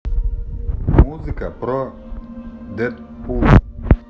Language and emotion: Russian, neutral